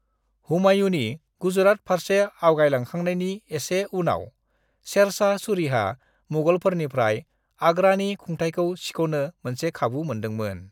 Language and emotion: Bodo, neutral